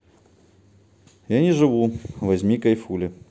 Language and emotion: Russian, neutral